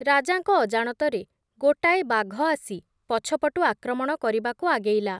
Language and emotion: Odia, neutral